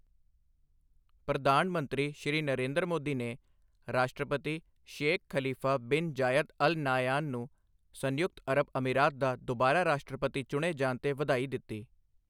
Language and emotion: Punjabi, neutral